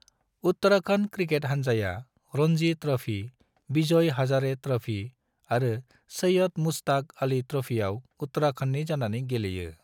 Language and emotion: Bodo, neutral